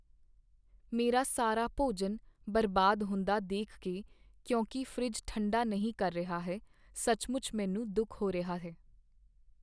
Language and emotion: Punjabi, sad